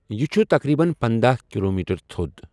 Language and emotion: Kashmiri, neutral